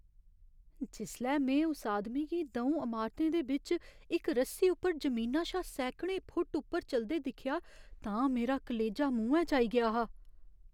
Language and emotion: Dogri, fearful